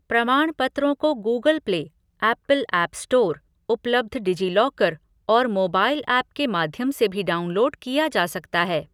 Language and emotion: Hindi, neutral